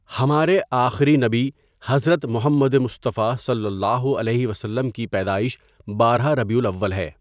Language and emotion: Urdu, neutral